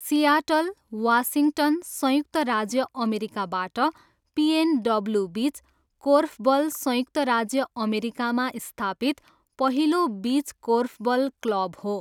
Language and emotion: Nepali, neutral